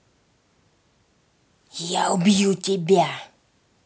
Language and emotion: Russian, angry